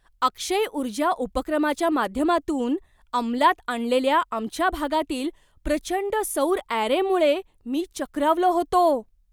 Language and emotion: Marathi, surprised